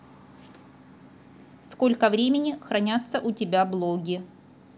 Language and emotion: Russian, neutral